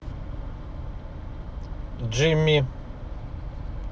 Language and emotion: Russian, neutral